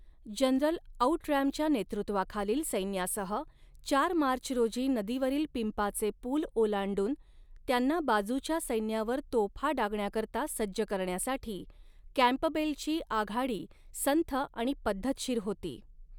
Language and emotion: Marathi, neutral